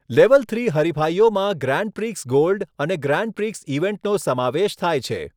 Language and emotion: Gujarati, neutral